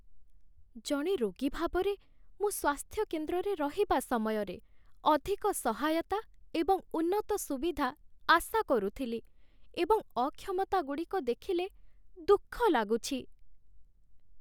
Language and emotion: Odia, sad